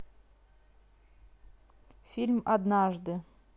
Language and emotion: Russian, neutral